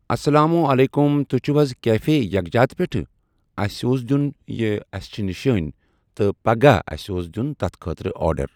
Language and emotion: Kashmiri, neutral